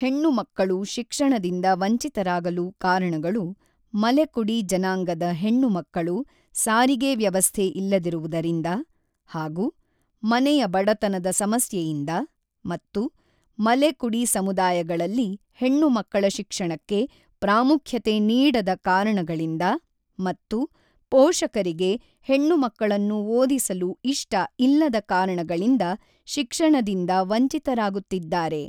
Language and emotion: Kannada, neutral